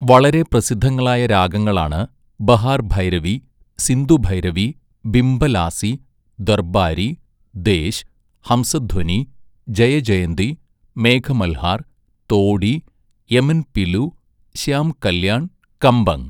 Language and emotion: Malayalam, neutral